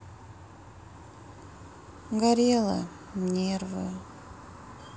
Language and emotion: Russian, sad